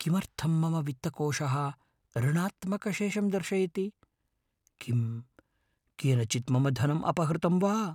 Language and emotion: Sanskrit, fearful